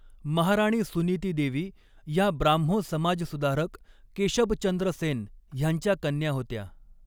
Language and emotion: Marathi, neutral